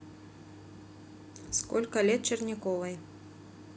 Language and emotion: Russian, neutral